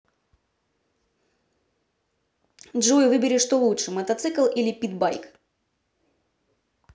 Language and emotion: Russian, neutral